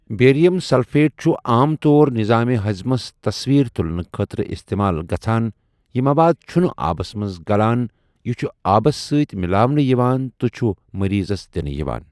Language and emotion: Kashmiri, neutral